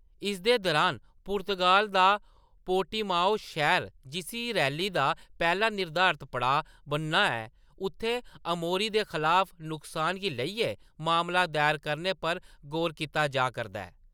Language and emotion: Dogri, neutral